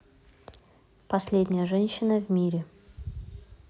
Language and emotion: Russian, neutral